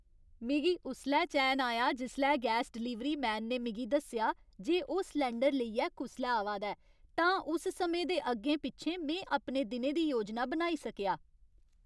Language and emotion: Dogri, happy